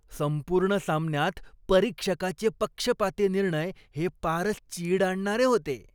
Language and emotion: Marathi, disgusted